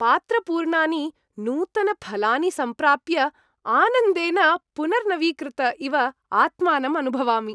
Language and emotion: Sanskrit, happy